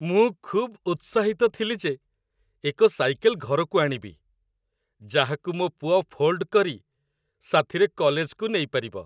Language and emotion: Odia, happy